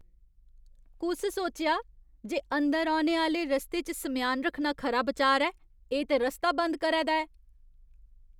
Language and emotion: Dogri, disgusted